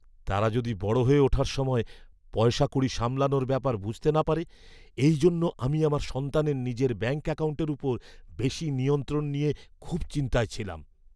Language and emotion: Bengali, fearful